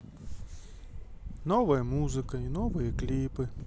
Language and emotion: Russian, sad